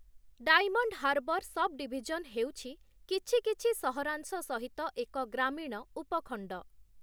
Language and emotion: Odia, neutral